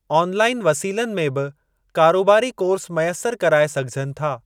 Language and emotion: Sindhi, neutral